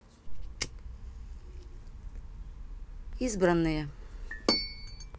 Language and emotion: Russian, neutral